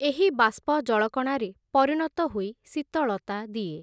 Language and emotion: Odia, neutral